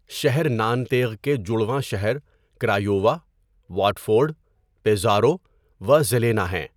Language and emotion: Urdu, neutral